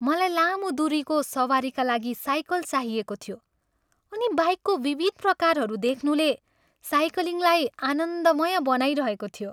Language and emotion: Nepali, happy